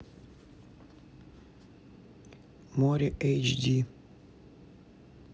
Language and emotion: Russian, neutral